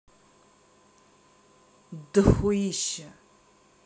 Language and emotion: Russian, neutral